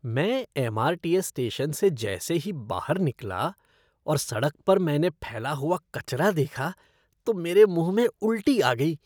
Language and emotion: Hindi, disgusted